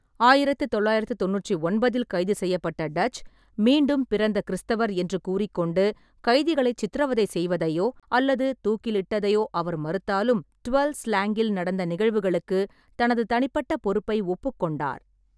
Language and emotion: Tamil, neutral